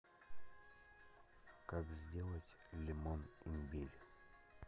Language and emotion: Russian, neutral